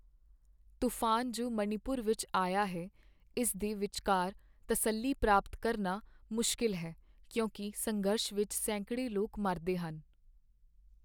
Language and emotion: Punjabi, sad